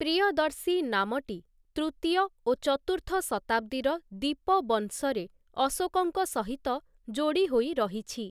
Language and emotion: Odia, neutral